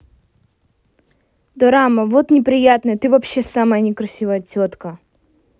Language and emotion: Russian, angry